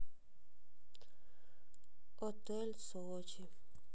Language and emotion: Russian, sad